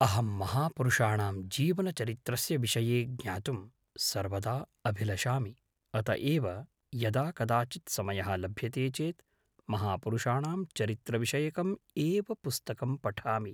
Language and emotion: Sanskrit, neutral